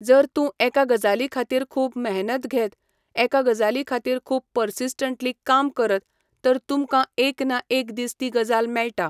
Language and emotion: Goan Konkani, neutral